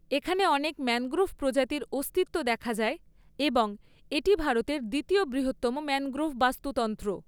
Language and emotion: Bengali, neutral